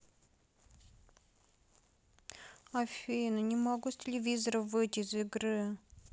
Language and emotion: Russian, sad